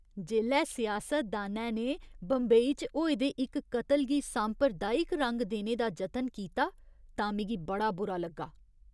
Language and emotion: Dogri, disgusted